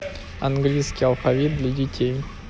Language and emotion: Russian, neutral